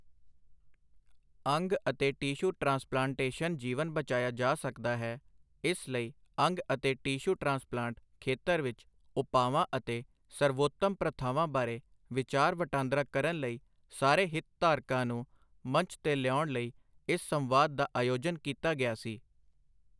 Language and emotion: Punjabi, neutral